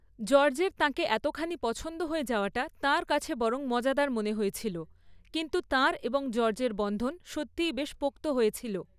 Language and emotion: Bengali, neutral